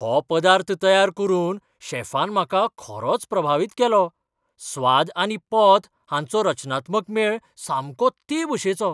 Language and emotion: Goan Konkani, surprised